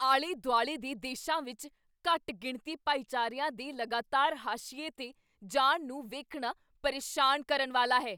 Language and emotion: Punjabi, angry